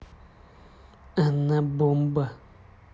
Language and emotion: Russian, neutral